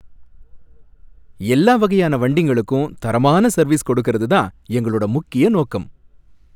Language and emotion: Tamil, happy